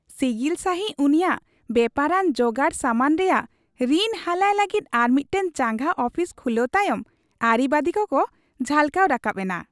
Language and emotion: Santali, happy